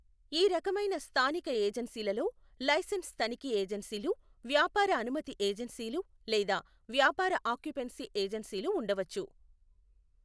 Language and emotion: Telugu, neutral